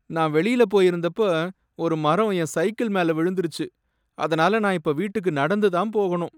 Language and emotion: Tamil, sad